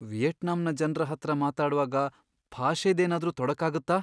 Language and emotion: Kannada, fearful